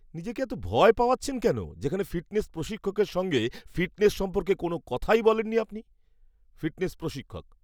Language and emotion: Bengali, angry